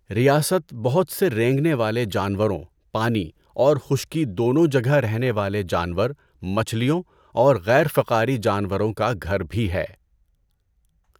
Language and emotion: Urdu, neutral